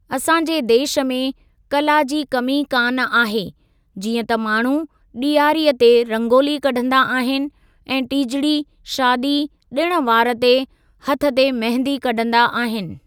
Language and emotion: Sindhi, neutral